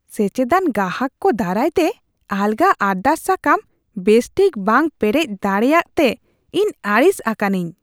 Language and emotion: Santali, disgusted